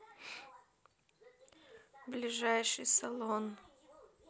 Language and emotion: Russian, neutral